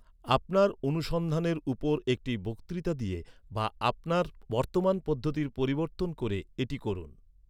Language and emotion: Bengali, neutral